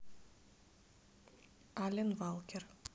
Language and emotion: Russian, neutral